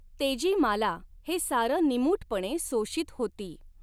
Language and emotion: Marathi, neutral